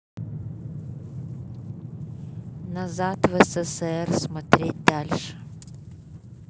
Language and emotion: Russian, neutral